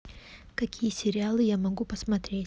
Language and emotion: Russian, neutral